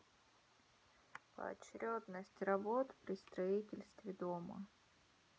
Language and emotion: Russian, neutral